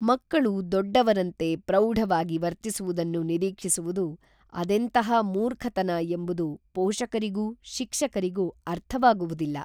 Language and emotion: Kannada, neutral